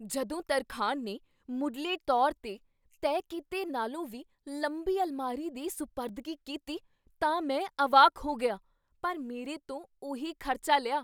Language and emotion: Punjabi, surprised